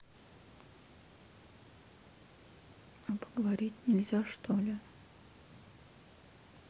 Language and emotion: Russian, sad